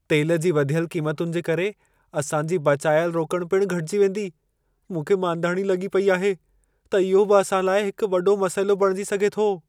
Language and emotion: Sindhi, fearful